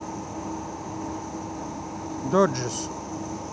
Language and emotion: Russian, neutral